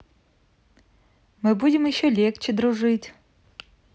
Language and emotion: Russian, positive